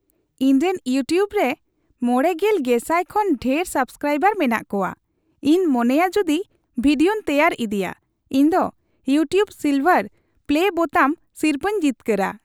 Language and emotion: Santali, happy